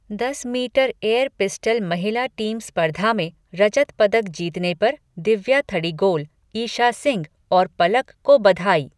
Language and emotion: Hindi, neutral